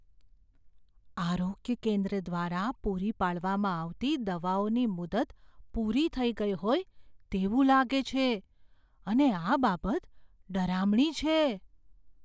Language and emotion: Gujarati, fearful